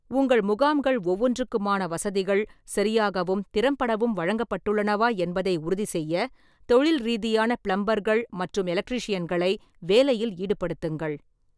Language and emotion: Tamil, neutral